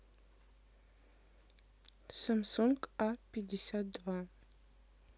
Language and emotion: Russian, neutral